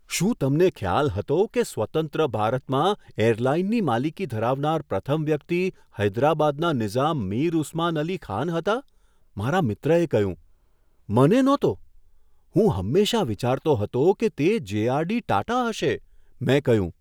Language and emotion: Gujarati, surprised